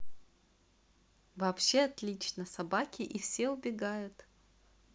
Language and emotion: Russian, positive